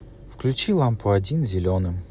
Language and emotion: Russian, neutral